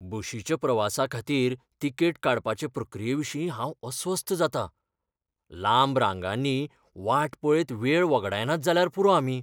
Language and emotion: Goan Konkani, fearful